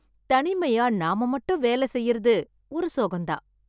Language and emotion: Tamil, happy